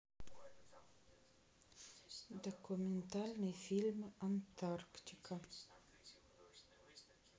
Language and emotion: Russian, neutral